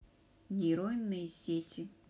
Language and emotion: Russian, neutral